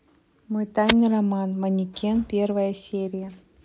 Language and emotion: Russian, neutral